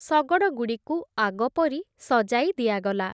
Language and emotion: Odia, neutral